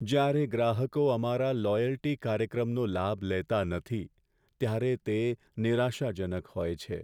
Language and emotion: Gujarati, sad